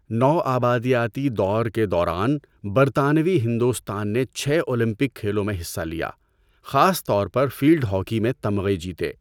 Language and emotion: Urdu, neutral